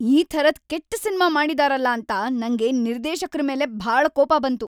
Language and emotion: Kannada, angry